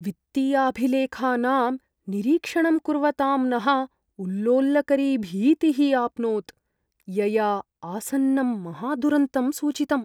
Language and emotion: Sanskrit, fearful